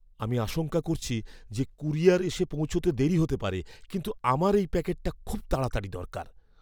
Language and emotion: Bengali, fearful